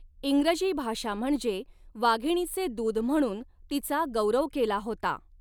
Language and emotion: Marathi, neutral